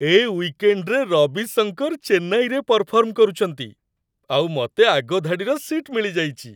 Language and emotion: Odia, happy